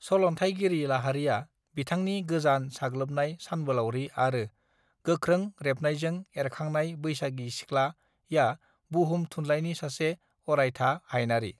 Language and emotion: Bodo, neutral